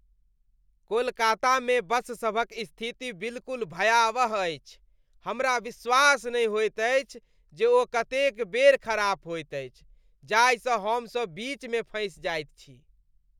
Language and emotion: Maithili, disgusted